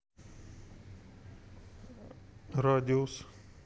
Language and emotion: Russian, neutral